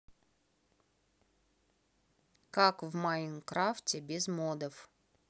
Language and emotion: Russian, neutral